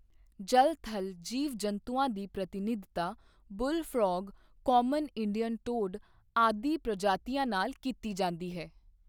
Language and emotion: Punjabi, neutral